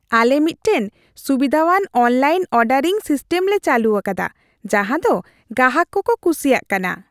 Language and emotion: Santali, happy